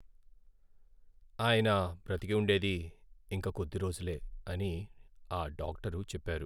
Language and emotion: Telugu, sad